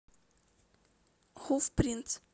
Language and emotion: Russian, neutral